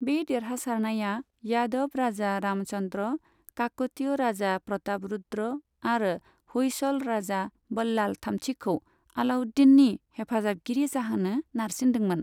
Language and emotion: Bodo, neutral